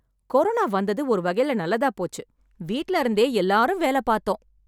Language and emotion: Tamil, happy